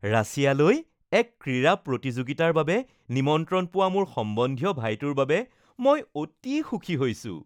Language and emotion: Assamese, happy